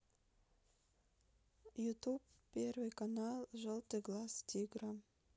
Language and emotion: Russian, neutral